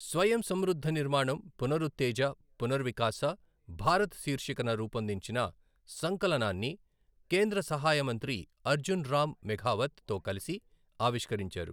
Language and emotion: Telugu, neutral